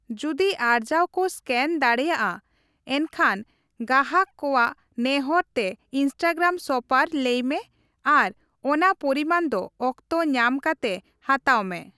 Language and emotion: Santali, neutral